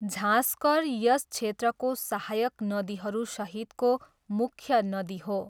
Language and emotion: Nepali, neutral